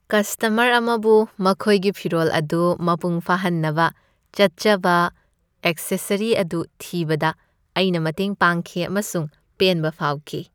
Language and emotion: Manipuri, happy